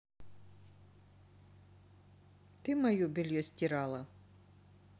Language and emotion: Russian, neutral